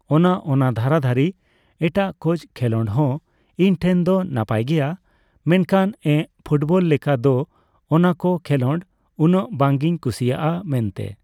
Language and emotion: Santali, neutral